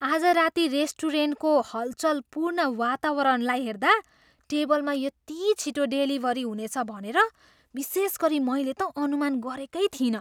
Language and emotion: Nepali, surprised